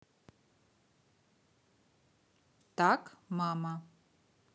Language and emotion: Russian, neutral